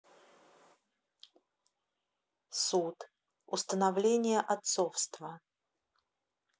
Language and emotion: Russian, neutral